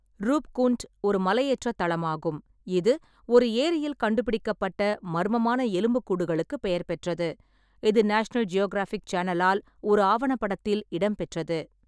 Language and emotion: Tamil, neutral